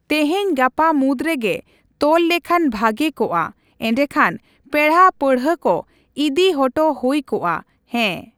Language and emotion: Santali, neutral